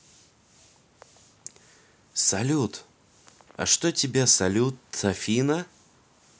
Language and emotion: Russian, positive